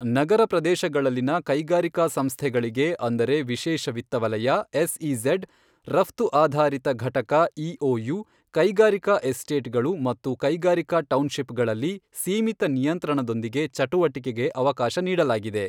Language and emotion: Kannada, neutral